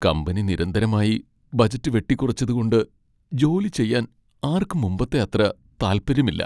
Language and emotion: Malayalam, sad